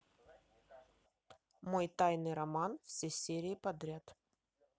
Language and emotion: Russian, neutral